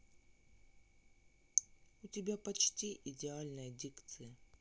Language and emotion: Russian, neutral